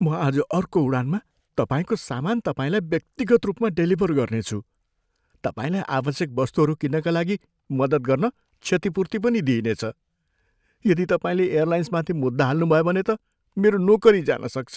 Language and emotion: Nepali, fearful